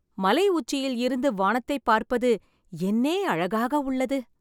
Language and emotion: Tamil, happy